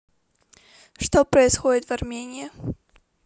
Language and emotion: Russian, neutral